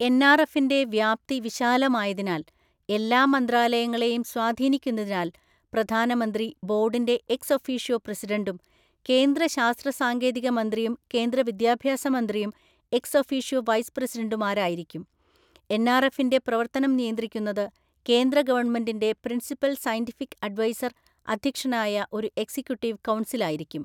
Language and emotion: Malayalam, neutral